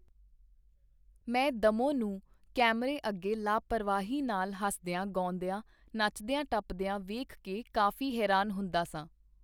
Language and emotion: Punjabi, neutral